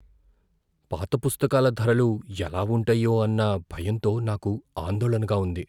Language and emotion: Telugu, fearful